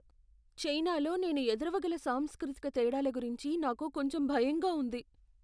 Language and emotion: Telugu, fearful